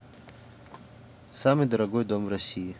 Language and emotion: Russian, neutral